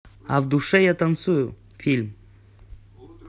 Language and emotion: Russian, neutral